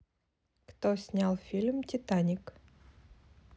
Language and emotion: Russian, neutral